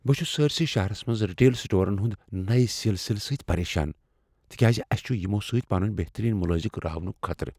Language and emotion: Kashmiri, fearful